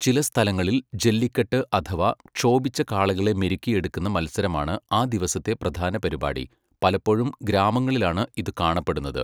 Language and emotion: Malayalam, neutral